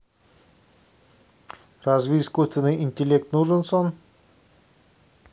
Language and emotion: Russian, neutral